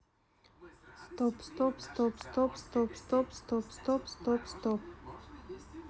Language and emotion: Russian, neutral